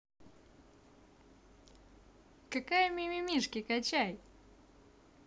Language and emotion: Russian, positive